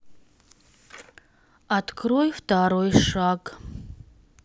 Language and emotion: Russian, neutral